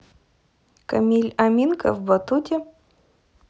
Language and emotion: Russian, neutral